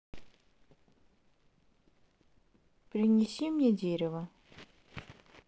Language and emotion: Russian, neutral